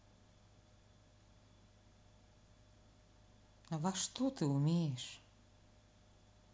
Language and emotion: Russian, sad